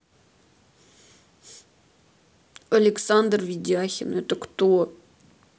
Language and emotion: Russian, sad